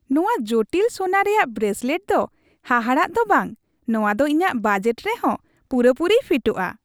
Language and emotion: Santali, happy